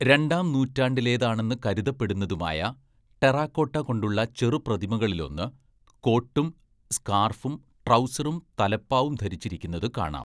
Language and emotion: Malayalam, neutral